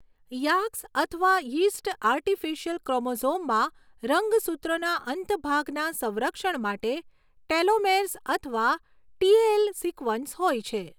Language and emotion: Gujarati, neutral